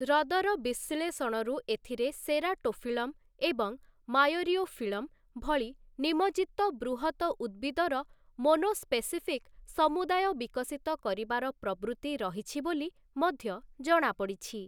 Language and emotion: Odia, neutral